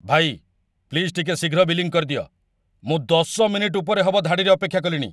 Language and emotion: Odia, angry